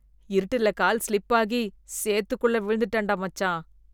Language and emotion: Tamil, disgusted